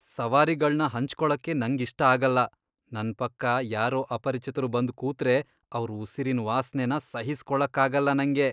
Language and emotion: Kannada, disgusted